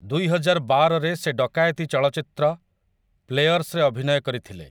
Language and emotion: Odia, neutral